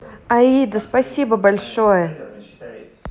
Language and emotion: Russian, positive